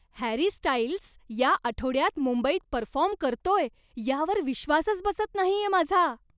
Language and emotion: Marathi, surprised